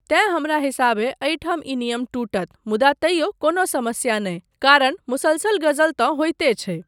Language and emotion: Maithili, neutral